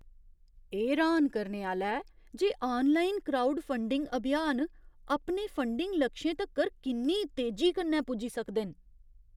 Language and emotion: Dogri, surprised